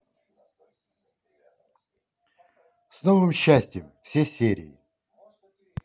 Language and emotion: Russian, positive